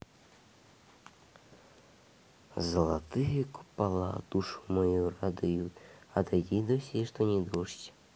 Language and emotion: Russian, neutral